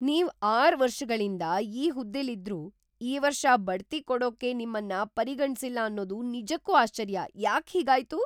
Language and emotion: Kannada, surprised